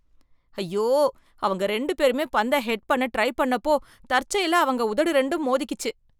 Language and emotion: Tamil, disgusted